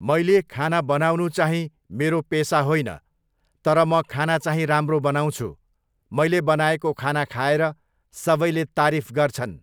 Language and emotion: Nepali, neutral